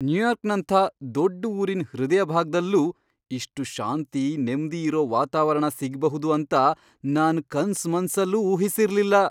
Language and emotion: Kannada, surprised